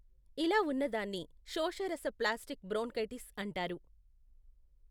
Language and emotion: Telugu, neutral